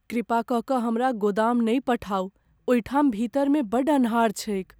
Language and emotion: Maithili, fearful